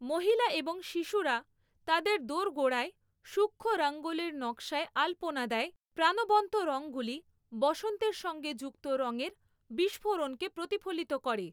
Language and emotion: Bengali, neutral